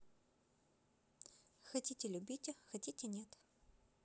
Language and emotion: Russian, neutral